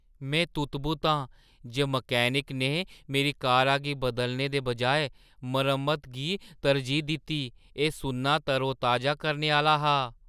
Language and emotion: Dogri, surprised